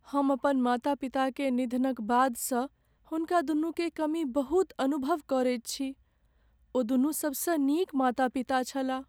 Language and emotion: Maithili, sad